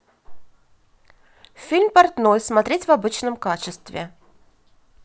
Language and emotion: Russian, positive